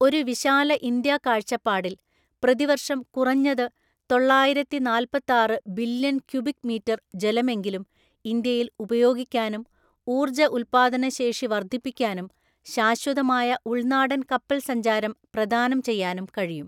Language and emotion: Malayalam, neutral